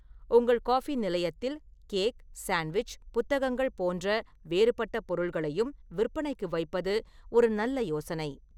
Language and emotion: Tamil, neutral